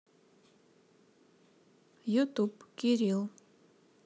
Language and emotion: Russian, neutral